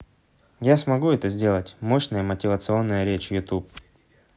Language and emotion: Russian, neutral